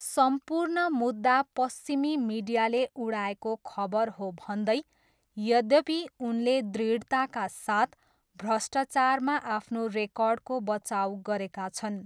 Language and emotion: Nepali, neutral